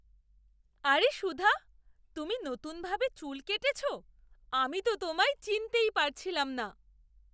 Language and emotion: Bengali, surprised